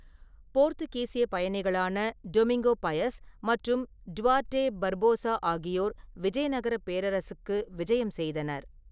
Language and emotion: Tamil, neutral